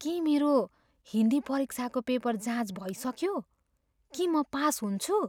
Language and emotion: Nepali, fearful